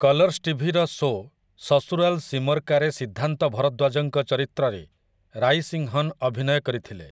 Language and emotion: Odia, neutral